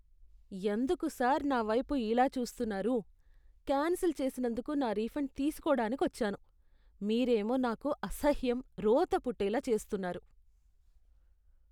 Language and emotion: Telugu, disgusted